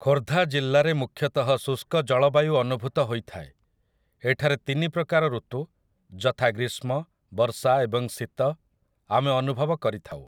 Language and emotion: Odia, neutral